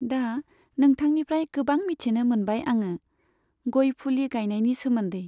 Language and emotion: Bodo, neutral